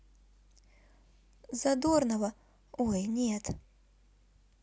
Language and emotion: Russian, neutral